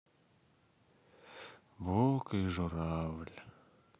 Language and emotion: Russian, sad